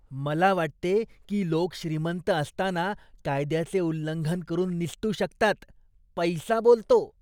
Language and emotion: Marathi, disgusted